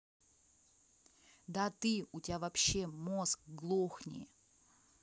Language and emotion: Russian, angry